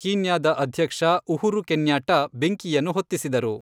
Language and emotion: Kannada, neutral